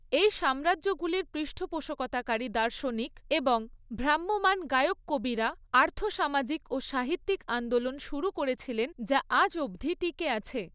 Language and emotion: Bengali, neutral